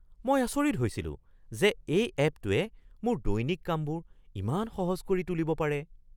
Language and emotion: Assamese, surprised